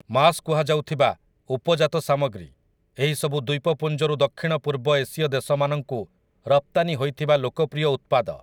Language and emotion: Odia, neutral